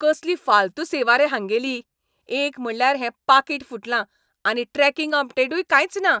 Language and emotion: Goan Konkani, angry